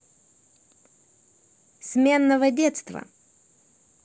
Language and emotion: Russian, neutral